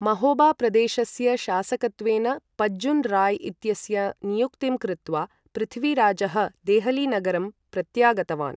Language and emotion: Sanskrit, neutral